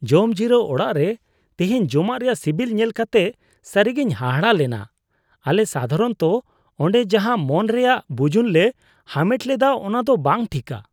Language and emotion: Santali, disgusted